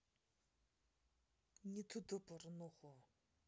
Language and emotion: Russian, neutral